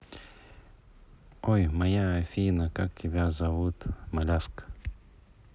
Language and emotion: Russian, neutral